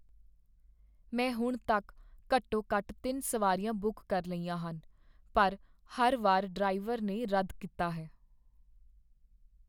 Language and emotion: Punjabi, sad